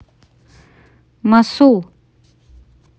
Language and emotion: Russian, neutral